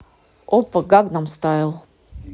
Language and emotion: Russian, neutral